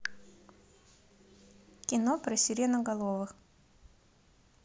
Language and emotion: Russian, neutral